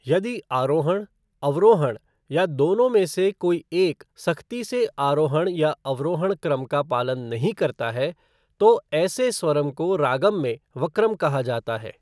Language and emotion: Hindi, neutral